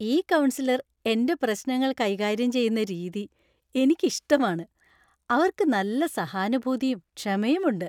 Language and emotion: Malayalam, happy